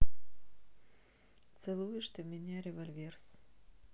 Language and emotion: Russian, neutral